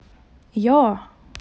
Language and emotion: Russian, positive